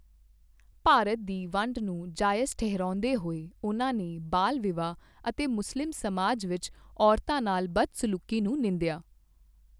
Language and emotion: Punjabi, neutral